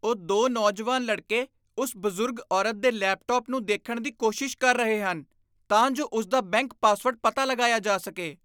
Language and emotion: Punjabi, disgusted